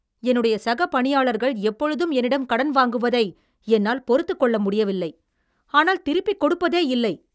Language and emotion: Tamil, angry